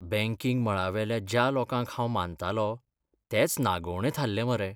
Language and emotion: Goan Konkani, sad